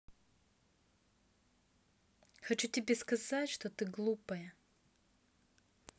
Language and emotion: Russian, neutral